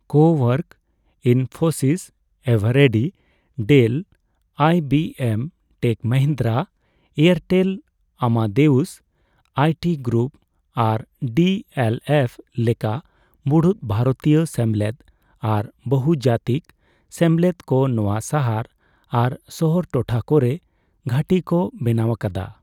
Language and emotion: Santali, neutral